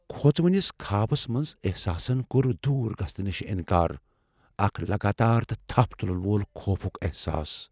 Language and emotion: Kashmiri, fearful